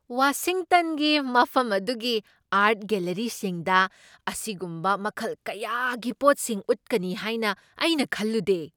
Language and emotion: Manipuri, surprised